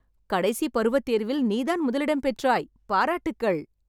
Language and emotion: Tamil, happy